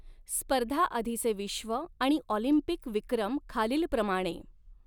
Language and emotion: Marathi, neutral